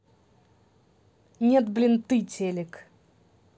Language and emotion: Russian, angry